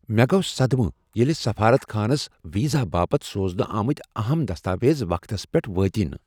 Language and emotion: Kashmiri, surprised